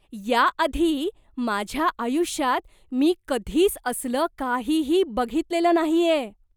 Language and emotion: Marathi, surprised